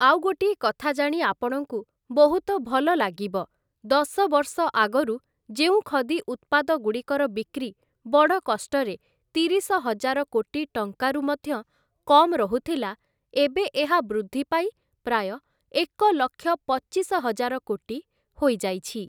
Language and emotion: Odia, neutral